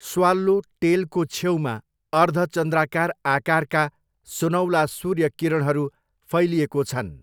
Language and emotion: Nepali, neutral